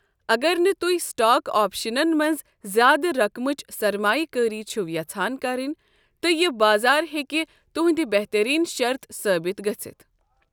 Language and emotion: Kashmiri, neutral